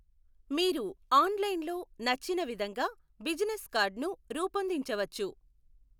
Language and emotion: Telugu, neutral